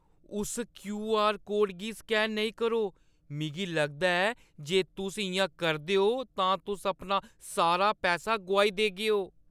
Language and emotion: Dogri, fearful